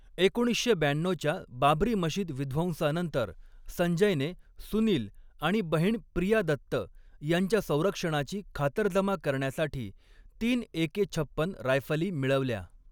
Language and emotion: Marathi, neutral